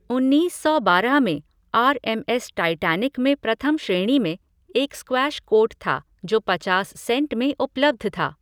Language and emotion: Hindi, neutral